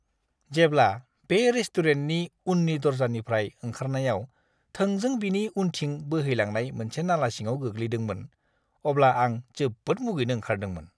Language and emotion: Bodo, disgusted